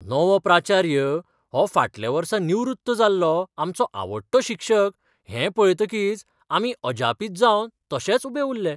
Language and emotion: Goan Konkani, surprised